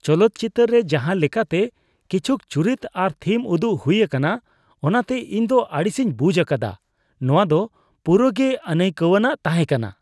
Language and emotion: Santali, disgusted